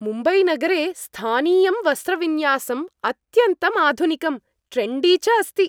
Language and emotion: Sanskrit, happy